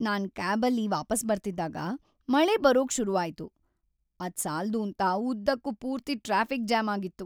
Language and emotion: Kannada, sad